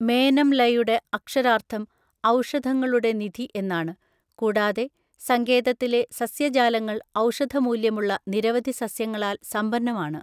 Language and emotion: Malayalam, neutral